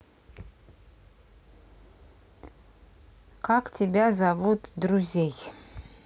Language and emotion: Russian, neutral